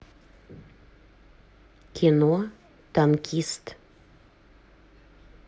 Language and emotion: Russian, neutral